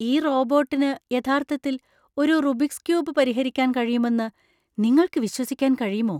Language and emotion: Malayalam, surprised